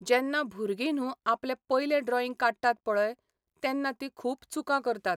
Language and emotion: Goan Konkani, neutral